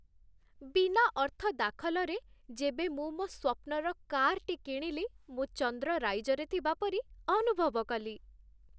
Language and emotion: Odia, happy